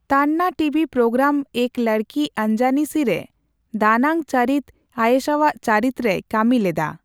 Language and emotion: Santali, neutral